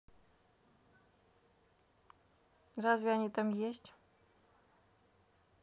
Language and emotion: Russian, neutral